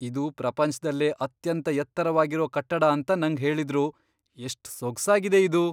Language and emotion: Kannada, surprised